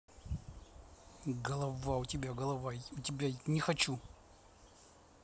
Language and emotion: Russian, angry